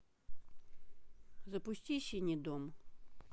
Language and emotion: Russian, neutral